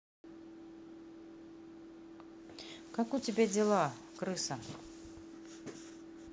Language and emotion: Russian, neutral